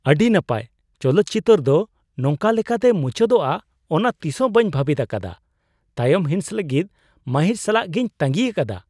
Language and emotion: Santali, surprised